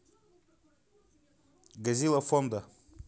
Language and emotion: Russian, neutral